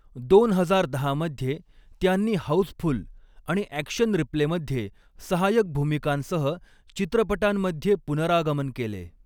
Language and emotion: Marathi, neutral